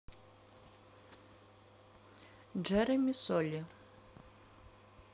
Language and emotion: Russian, neutral